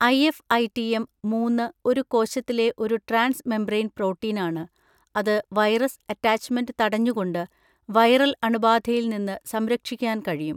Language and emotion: Malayalam, neutral